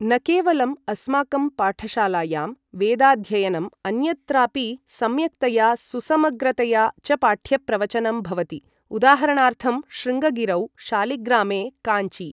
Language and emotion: Sanskrit, neutral